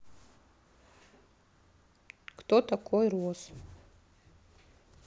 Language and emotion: Russian, neutral